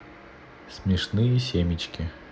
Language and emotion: Russian, neutral